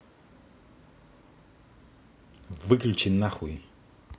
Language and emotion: Russian, angry